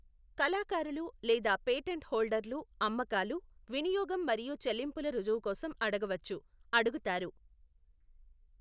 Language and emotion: Telugu, neutral